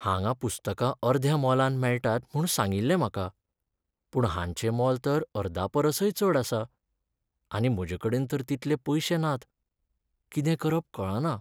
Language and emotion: Goan Konkani, sad